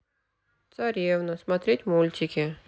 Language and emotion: Russian, sad